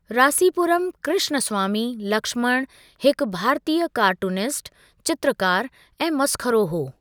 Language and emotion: Sindhi, neutral